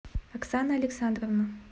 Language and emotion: Russian, neutral